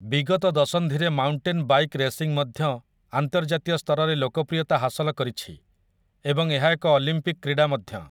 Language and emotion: Odia, neutral